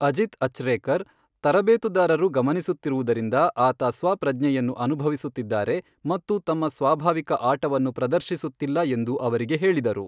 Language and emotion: Kannada, neutral